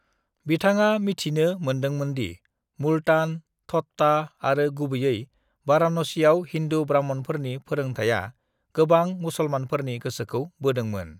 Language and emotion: Bodo, neutral